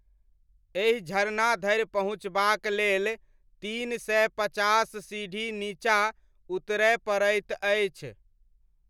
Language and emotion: Maithili, neutral